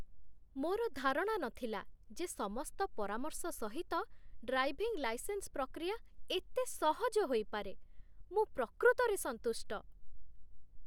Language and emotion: Odia, surprised